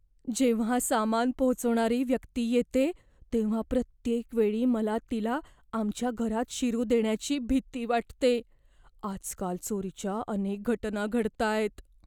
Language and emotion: Marathi, fearful